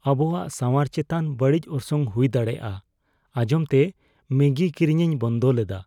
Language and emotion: Santali, fearful